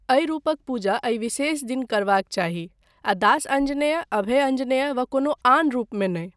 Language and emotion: Maithili, neutral